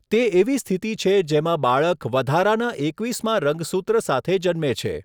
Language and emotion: Gujarati, neutral